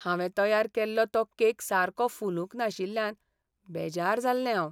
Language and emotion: Goan Konkani, sad